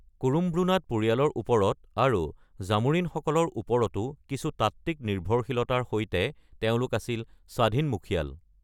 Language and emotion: Assamese, neutral